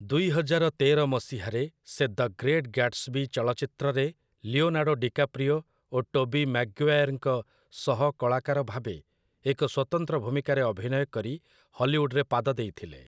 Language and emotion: Odia, neutral